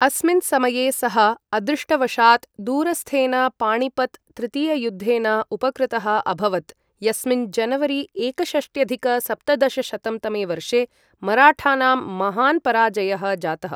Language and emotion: Sanskrit, neutral